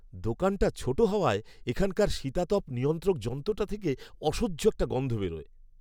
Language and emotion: Bengali, disgusted